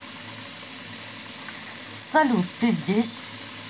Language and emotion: Russian, neutral